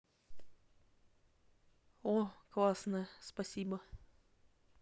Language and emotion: Russian, positive